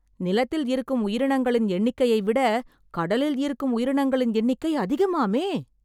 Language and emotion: Tamil, surprised